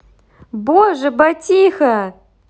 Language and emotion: Russian, positive